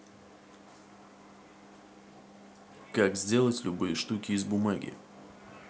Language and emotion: Russian, neutral